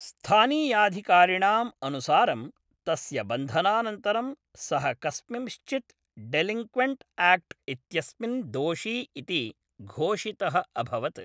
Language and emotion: Sanskrit, neutral